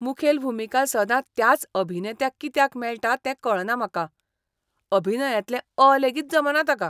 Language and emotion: Goan Konkani, disgusted